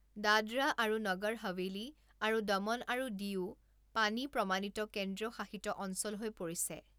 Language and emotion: Assamese, neutral